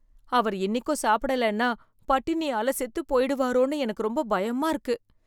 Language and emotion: Tamil, fearful